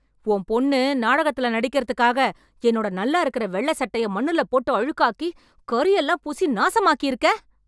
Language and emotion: Tamil, angry